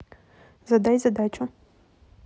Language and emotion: Russian, neutral